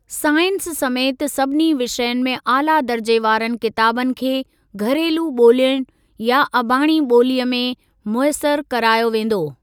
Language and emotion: Sindhi, neutral